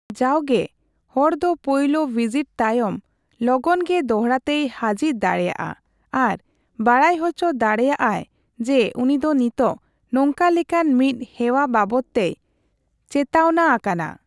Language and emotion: Santali, neutral